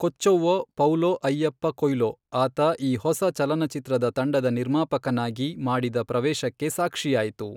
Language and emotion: Kannada, neutral